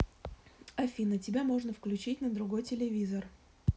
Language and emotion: Russian, neutral